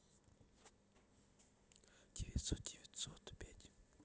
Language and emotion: Russian, neutral